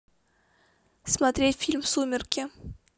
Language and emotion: Russian, neutral